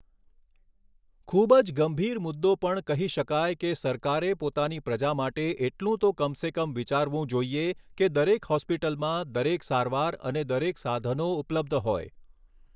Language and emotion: Gujarati, neutral